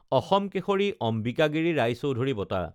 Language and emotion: Assamese, neutral